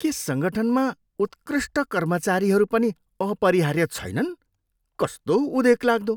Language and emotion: Nepali, disgusted